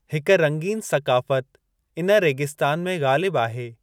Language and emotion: Sindhi, neutral